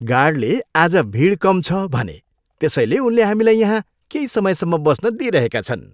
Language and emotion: Nepali, happy